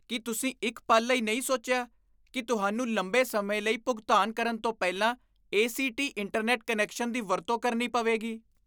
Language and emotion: Punjabi, disgusted